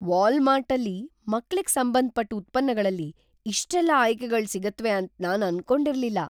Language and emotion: Kannada, surprised